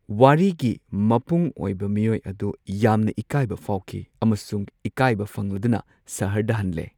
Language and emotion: Manipuri, neutral